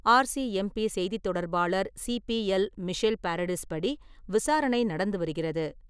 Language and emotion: Tamil, neutral